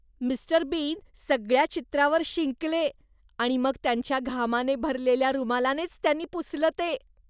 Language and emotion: Marathi, disgusted